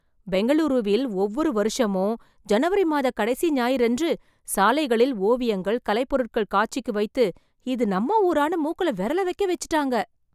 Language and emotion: Tamil, surprised